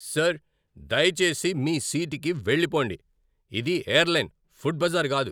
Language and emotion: Telugu, angry